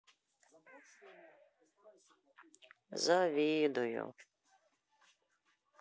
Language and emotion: Russian, sad